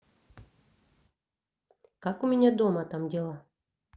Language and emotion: Russian, neutral